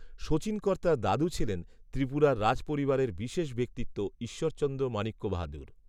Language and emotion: Bengali, neutral